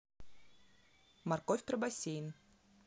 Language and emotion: Russian, neutral